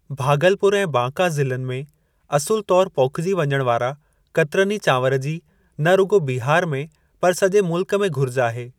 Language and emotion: Sindhi, neutral